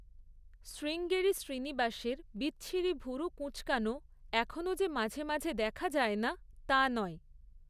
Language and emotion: Bengali, neutral